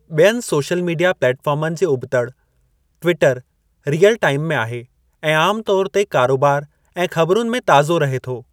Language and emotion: Sindhi, neutral